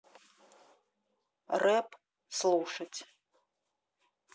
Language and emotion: Russian, neutral